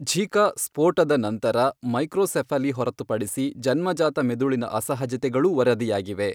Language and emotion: Kannada, neutral